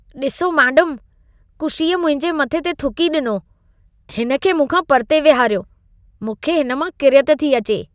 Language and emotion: Sindhi, disgusted